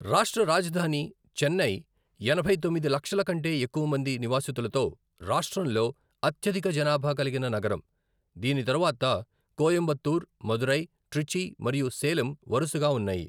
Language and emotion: Telugu, neutral